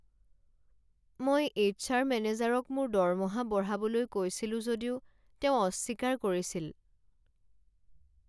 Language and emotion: Assamese, sad